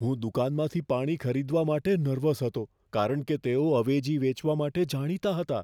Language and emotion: Gujarati, fearful